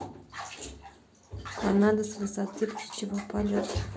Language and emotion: Russian, neutral